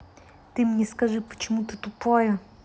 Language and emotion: Russian, angry